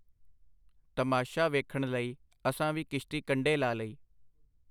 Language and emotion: Punjabi, neutral